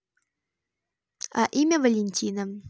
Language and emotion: Russian, neutral